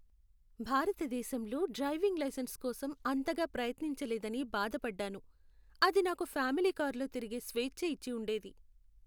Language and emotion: Telugu, sad